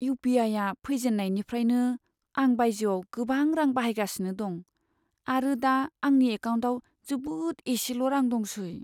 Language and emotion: Bodo, sad